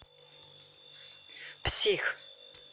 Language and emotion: Russian, angry